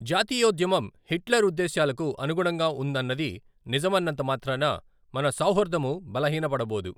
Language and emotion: Telugu, neutral